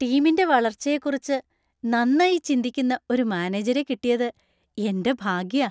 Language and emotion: Malayalam, happy